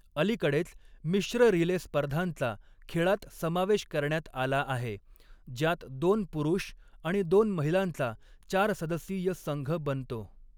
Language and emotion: Marathi, neutral